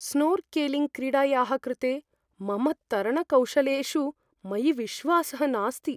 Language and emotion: Sanskrit, fearful